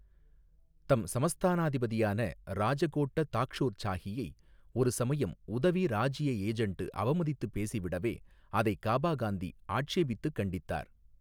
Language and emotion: Tamil, neutral